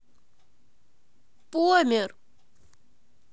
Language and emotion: Russian, neutral